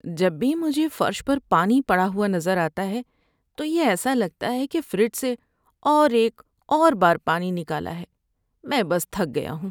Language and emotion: Urdu, sad